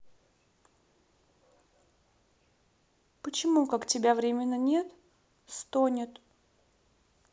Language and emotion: Russian, sad